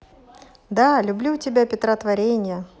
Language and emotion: Russian, positive